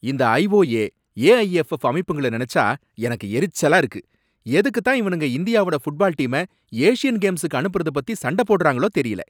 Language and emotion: Tamil, angry